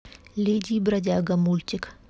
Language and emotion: Russian, neutral